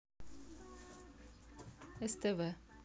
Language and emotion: Russian, neutral